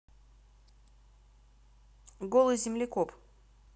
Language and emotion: Russian, neutral